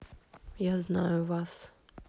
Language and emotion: Russian, neutral